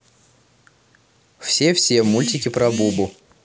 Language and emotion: Russian, neutral